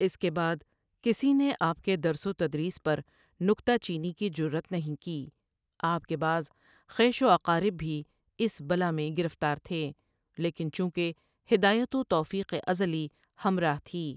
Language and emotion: Urdu, neutral